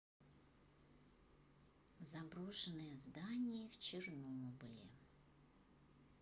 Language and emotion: Russian, neutral